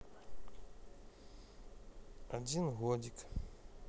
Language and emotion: Russian, neutral